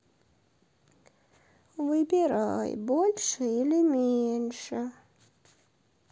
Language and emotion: Russian, sad